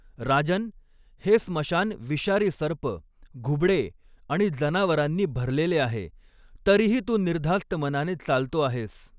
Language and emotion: Marathi, neutral